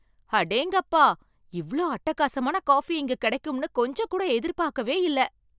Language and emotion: Tamil, surprised